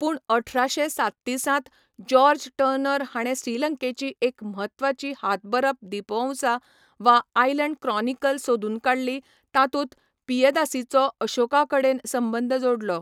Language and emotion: Goan Konkani, neutral